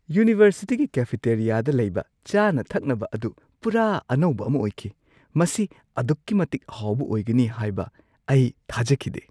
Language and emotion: Manipuri, surprised